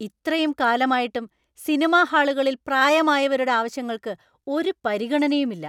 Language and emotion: Malayalam, angry